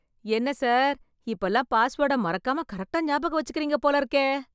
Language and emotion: Tamil, surprised